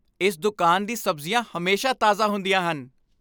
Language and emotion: Punjabi, happy